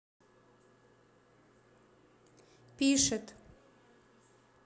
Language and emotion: Russian, neutral